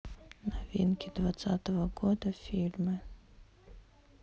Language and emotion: Russian, neutral